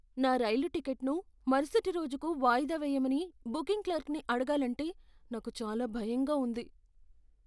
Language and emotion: Telugu, fearful